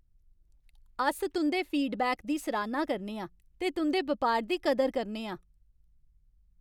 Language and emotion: Dogri, happy